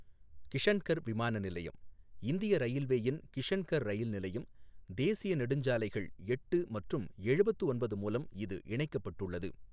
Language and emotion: Tamil, neutral